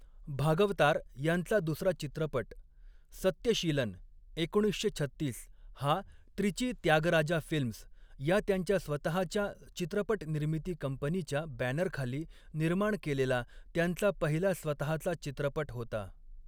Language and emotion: Marathi, neutral